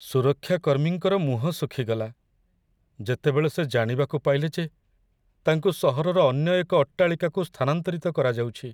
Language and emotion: Odia, sad